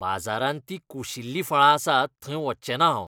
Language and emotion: Goan Konkani, disgusted